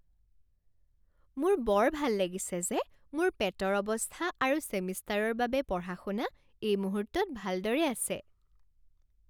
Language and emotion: Assamese, happy